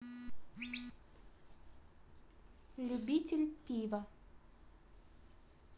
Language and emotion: Russian, neutral